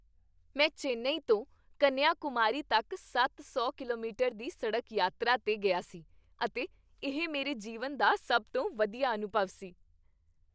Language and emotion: Punjabi, happy